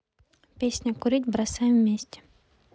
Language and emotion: Russian, neutral